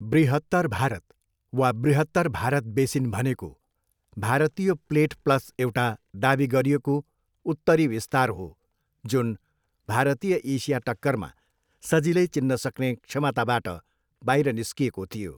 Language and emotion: Nepali, neutral